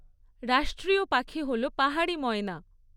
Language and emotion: Bengali, neutral